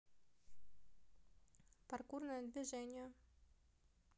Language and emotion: Russian, neutral